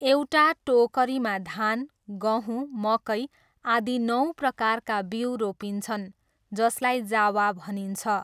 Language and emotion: Nepali, neutral